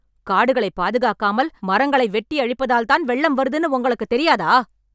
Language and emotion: Tamil, angry